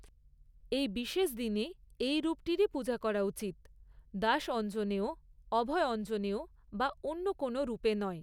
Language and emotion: Bengali, neutral